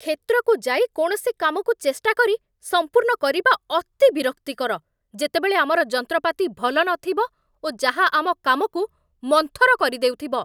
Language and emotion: Odia, angry